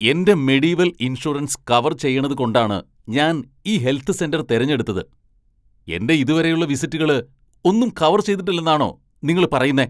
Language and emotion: Malayalam, angry